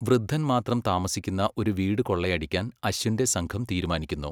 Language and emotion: Malayalam, neutral